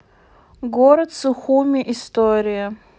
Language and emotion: Russian, neutral